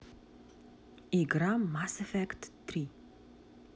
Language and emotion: Russian, neutral